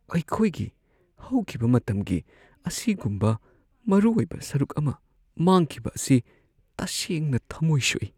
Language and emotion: Manipuri, sad